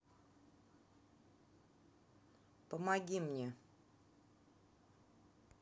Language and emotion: Russian, neutral